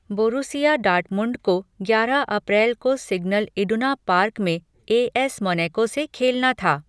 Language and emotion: Hindi, neutral